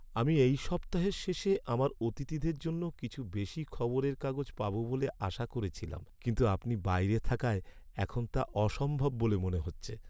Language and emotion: Bengali, sad